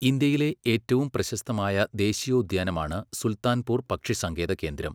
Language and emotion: Malayalam, neutral